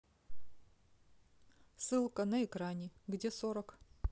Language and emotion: Russian, neutral